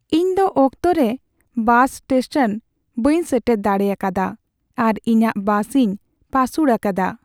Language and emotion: Santali, sad